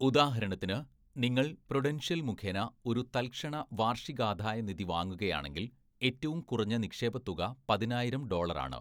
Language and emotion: Malayalam, neutral